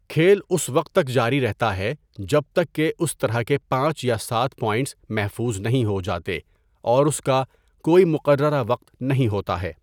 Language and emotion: Urdu, neutral